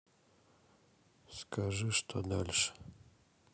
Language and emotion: Russian, sad